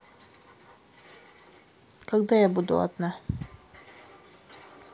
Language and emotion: Russian, neutral